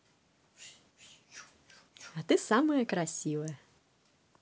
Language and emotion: Russian, positive